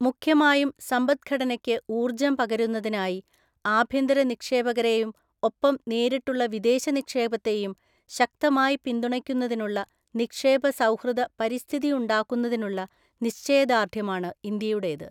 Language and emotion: Malayalam, neutral